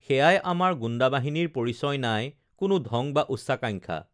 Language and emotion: Assamese, neutral